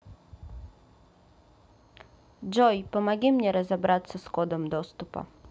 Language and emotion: Russian, neutral